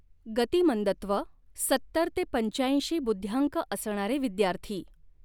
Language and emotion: Marathi, neutral